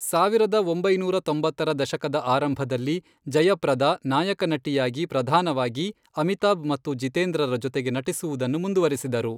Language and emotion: Kannada, neutral